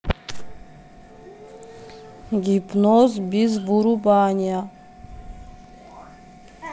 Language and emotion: Russian, neutral